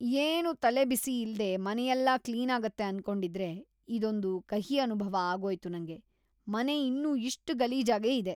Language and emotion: Kannada, disgusted